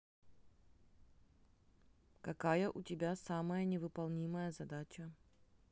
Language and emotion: Russian, neutral